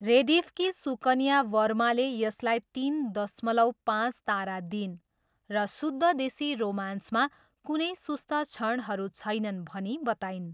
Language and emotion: Nepali, neutral